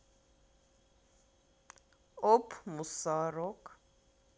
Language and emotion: Russian, positive